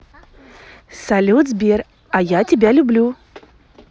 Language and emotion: Russian, positive